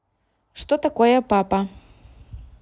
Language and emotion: Russian, neutral